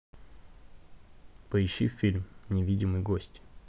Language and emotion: Russian, neutral